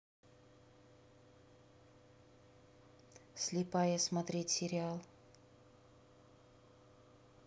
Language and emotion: Russian, neutral